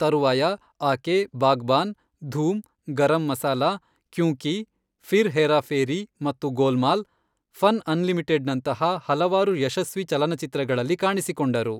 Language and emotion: Kannada, neutral